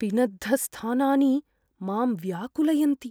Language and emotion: Sanskrit, fearful